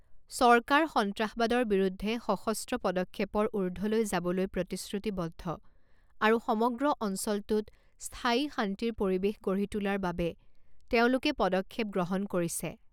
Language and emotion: Assamese, neutral